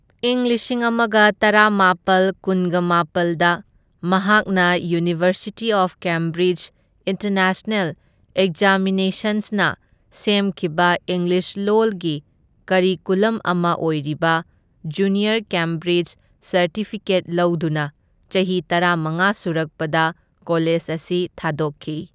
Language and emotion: Manipuri, neutral